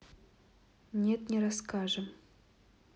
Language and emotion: Russian, neutral